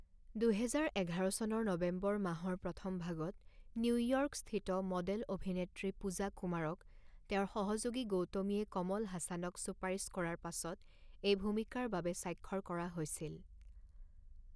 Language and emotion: Assamese, neutral